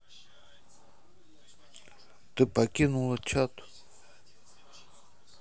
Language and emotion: Russian, neutral